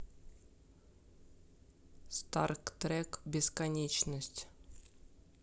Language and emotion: Russian, neutral